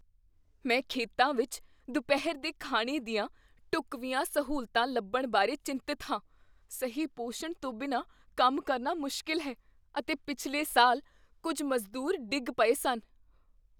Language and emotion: Punjabi, fearful